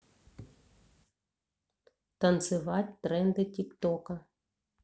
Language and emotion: Russian, neutral